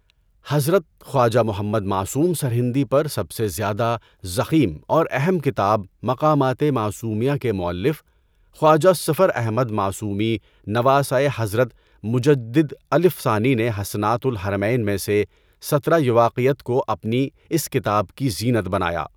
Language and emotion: Urdu, neutral